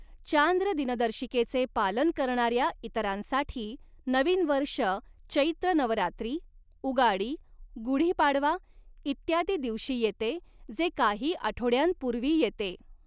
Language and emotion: Marathi, neutral